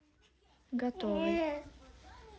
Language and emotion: Russian, neutral